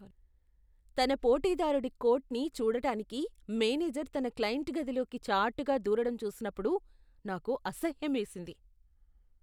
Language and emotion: Telugu, disgusted